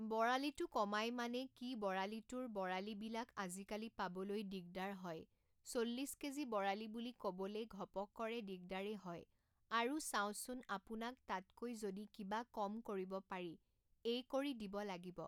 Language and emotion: Assamese, neutral